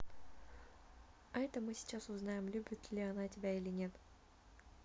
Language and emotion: Russian, neutral